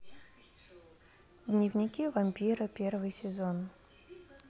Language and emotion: Russian, neutral